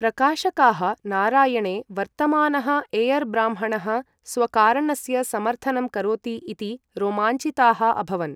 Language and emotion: Sanskrit, neutral